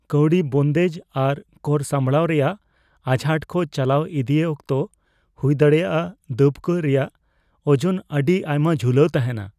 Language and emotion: Santali, fearful